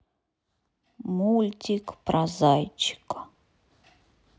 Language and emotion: Russian, sad